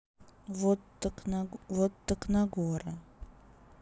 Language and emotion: Russian, neutral